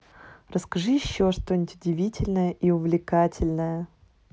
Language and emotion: Russian, neutral